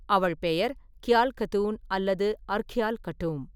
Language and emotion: Tamil, neutral